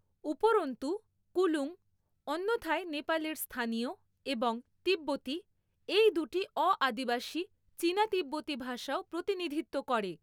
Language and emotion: Bengali, neutral